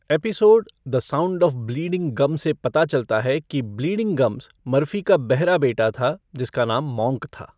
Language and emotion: Hindi, neutral